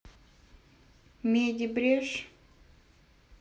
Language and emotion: Russian, neutral